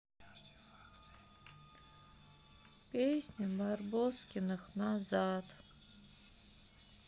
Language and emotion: Russian, sad